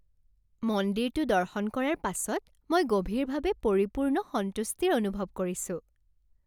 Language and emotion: Assamese, happy